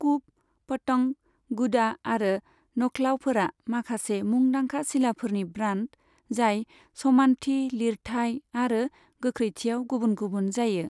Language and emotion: Bodo, neutral